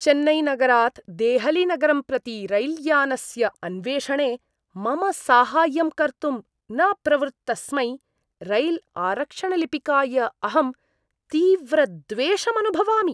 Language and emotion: Sanskrit, disgusted